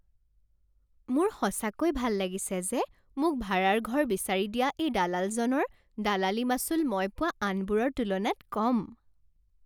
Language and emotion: Assamese, happy